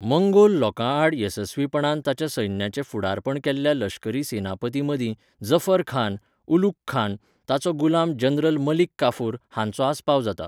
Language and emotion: Goan Konkani, neutral